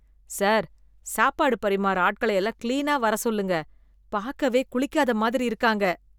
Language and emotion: Tamil, disgusted